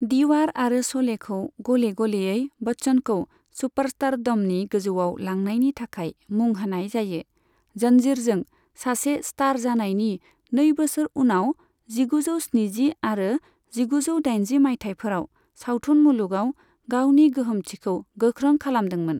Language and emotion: Bodo, neutral